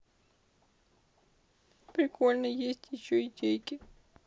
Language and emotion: Russian, sad